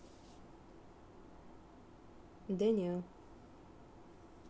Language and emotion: Russian, neutral